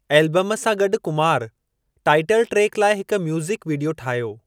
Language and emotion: Sindhi, neutral